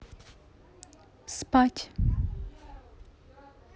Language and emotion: Russian, neutral